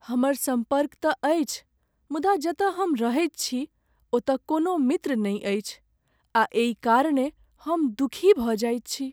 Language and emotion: Maithili, sad